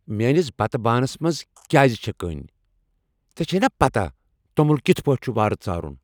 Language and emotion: Kashmiri, angry